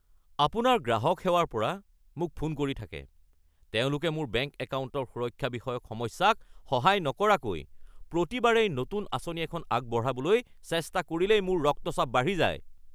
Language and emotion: Assamese, angry